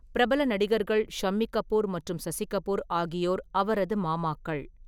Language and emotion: Tamil, neutral